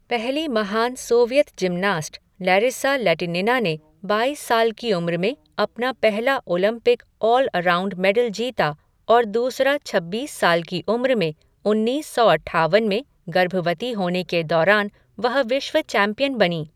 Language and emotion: Hindi, neutral